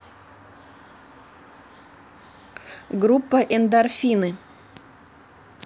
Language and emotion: Russian, neutral